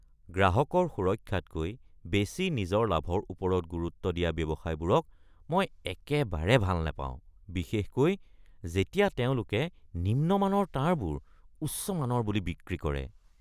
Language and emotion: Assamese, disgusted